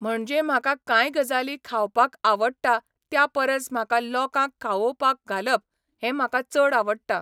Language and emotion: Goan Konkani, neutral